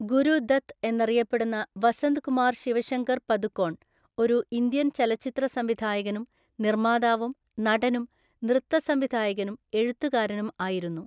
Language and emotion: Malayalam, neutral